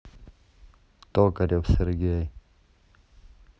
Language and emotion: Russian, neutral